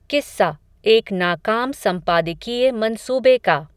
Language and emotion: Hindi, neutral